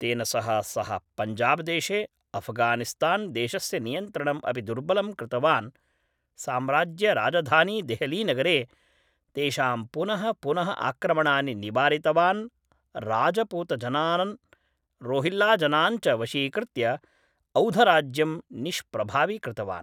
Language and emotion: Sanskrit, neutral